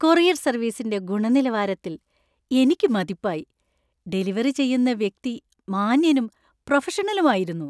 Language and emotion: Malayalam, happy